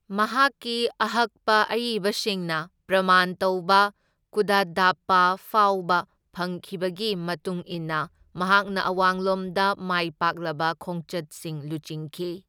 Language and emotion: Manipuri, neutral